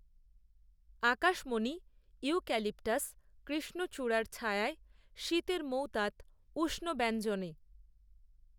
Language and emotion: Bengali, neutral